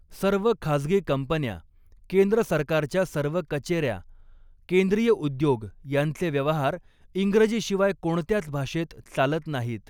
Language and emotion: Marathi, neutral